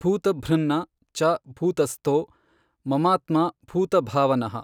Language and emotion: Kannada, neutral